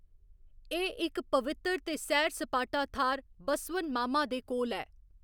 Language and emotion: Dogri, neutral